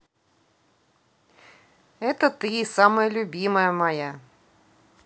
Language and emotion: Russian, positive